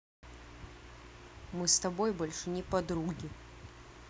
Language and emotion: Russian, angry